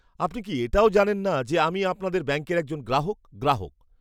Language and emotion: Bengali, disgusted